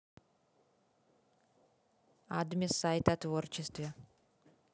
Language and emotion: Russian, neutral